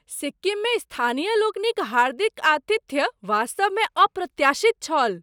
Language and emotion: Maithili, surprised